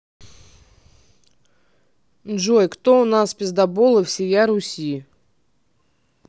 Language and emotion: Russian, neutral